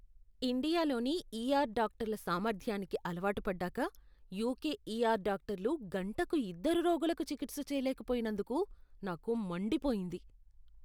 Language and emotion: Telugu, disgusted